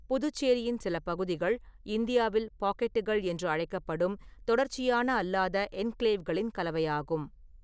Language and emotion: Tamil, neutral